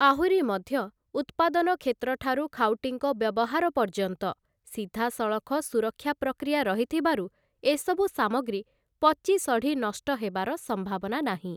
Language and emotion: Odia, neutral